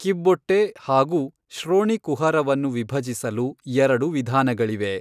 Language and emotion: Kannada, neutral